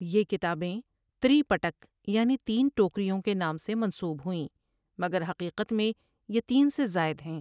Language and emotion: Urdu, neutral